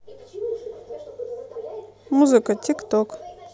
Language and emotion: Russian, neutral